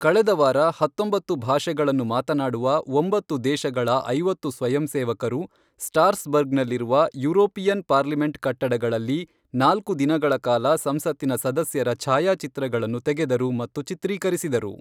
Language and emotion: Kannada, neutral